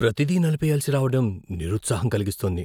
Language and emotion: Telugu, fearful